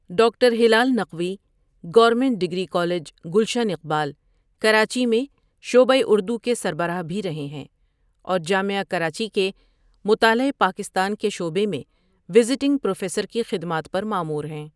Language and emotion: Urdu, neutral